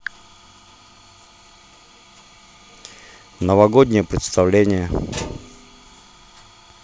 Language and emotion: Russian, neutral